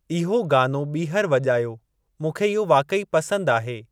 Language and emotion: Sindhi, neutral